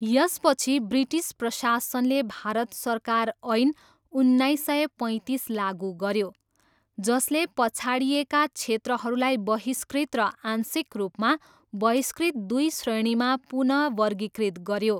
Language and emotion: Nepali, neutral